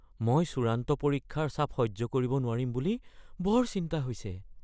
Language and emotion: Assamese, fearful